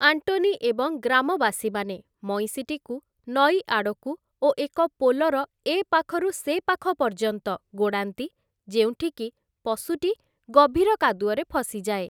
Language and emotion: Odia, neutral